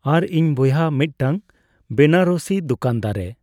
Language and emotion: Santali, neutral